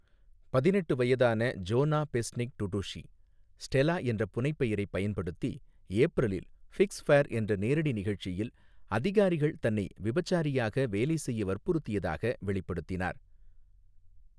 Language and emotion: Tamil, neutral